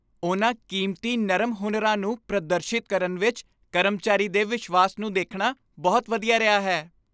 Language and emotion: Punjabi, happy